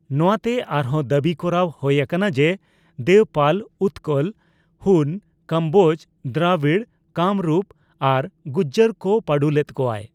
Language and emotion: Santali, neutral